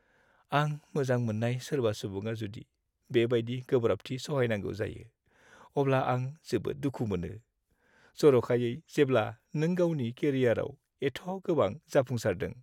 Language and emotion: Bodo, sad